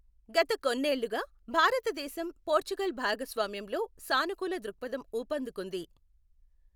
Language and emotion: Telugu, neutral